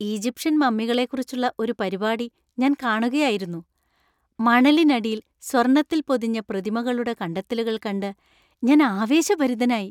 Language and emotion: Malayalam, happy